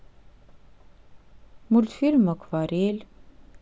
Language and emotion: Russian, sad